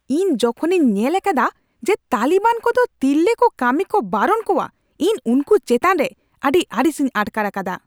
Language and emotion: Santali, angry